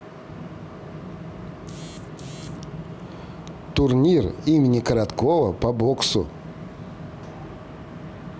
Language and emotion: Russian, neutral